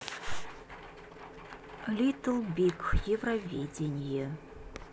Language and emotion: Russian, neutral